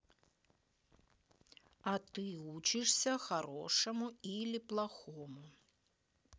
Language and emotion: Russian, neutral